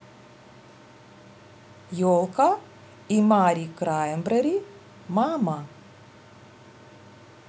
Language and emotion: Russian, neutral